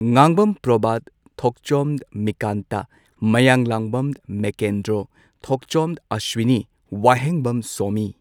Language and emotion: Manipuri, neutral